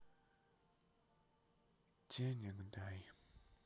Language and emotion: Russian, sad